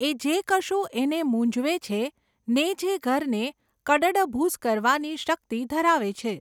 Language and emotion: Gujarati, neutral